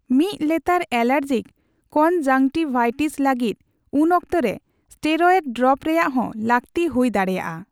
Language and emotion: Santali, neutral